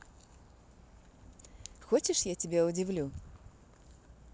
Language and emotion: Russian, positive